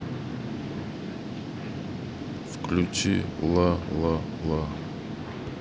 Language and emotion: Russian, neutral